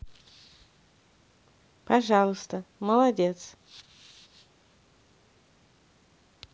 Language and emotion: Russian, neutral